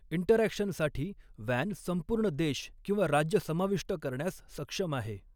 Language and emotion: Marathi, neutral